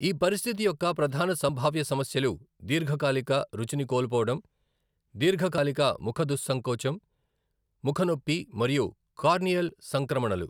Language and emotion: Telugu, neutral